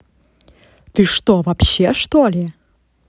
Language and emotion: Russian, angry